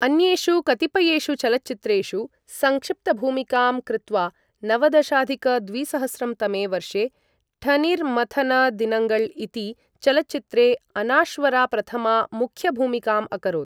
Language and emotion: Sanskrit, neutral